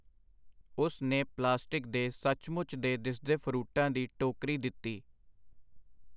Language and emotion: Punjabi, neutral